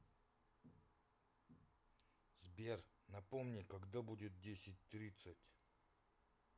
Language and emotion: Russian, neutral